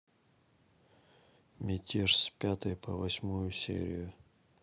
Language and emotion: Russian, neutral